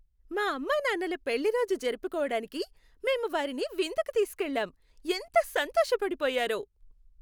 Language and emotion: Telugu, happy